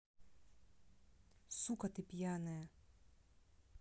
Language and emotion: Russian, angry